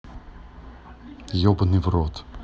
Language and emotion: Russian, neutral